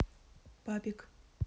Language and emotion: Russian, neutral